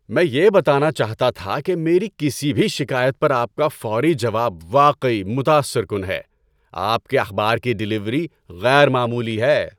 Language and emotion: Urdu, happy